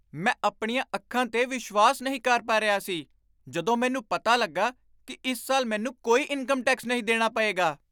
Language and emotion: Punjabi, surprised